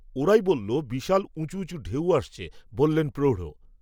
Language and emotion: Bengali, neutral